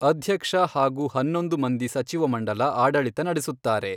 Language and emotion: Kannada, neutral